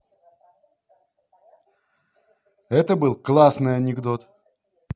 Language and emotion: Russian, positive